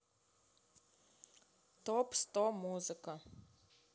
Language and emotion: Russian, neutral